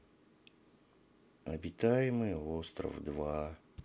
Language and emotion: Russian, sad